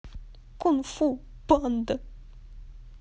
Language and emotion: Russian, sad